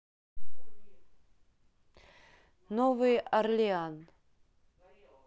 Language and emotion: Russian, neutral